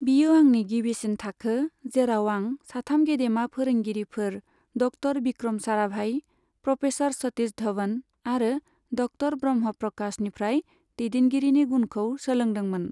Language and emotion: Bodo, neutral